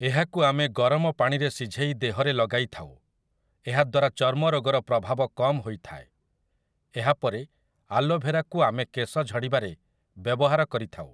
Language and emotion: Odia, neutral